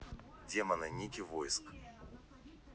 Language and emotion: Russian, neutral